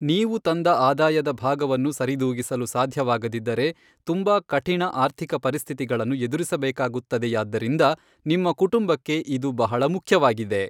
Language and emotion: Kannada, neutral